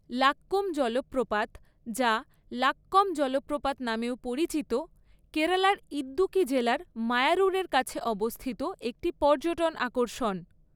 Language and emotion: Bengali, neutral